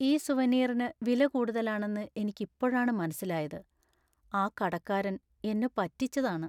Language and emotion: Malayalam, sad